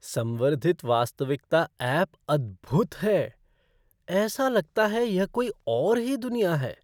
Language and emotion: Hindi, surprised